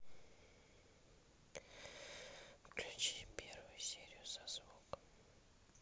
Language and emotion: Russian, neutral